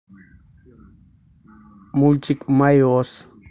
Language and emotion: Russian, neutral